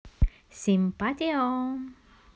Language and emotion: Russian, positive